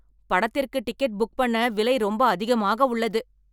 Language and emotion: Tamil, angry